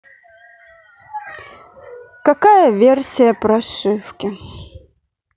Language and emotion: Russian, sad